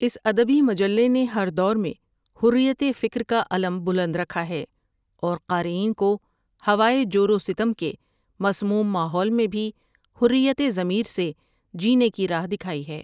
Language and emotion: Urdu, neutral